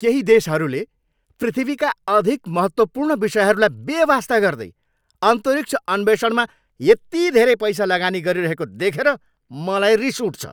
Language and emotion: Nepali, angry